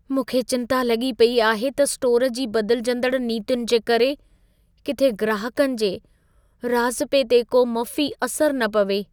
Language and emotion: Sindhi, fearful